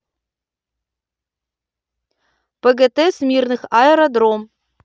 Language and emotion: Russian, neutral